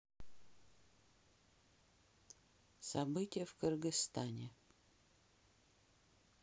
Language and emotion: Russian, neutral